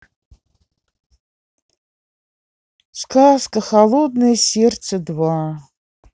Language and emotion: Russian, sad